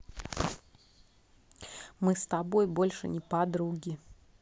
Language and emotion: Russian, neutral